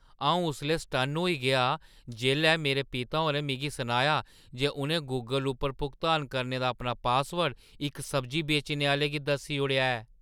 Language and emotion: Dogri, surprised